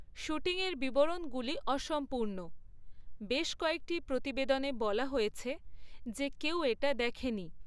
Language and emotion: Bengali, neutral